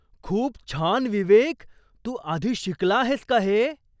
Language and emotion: Marathi, surprised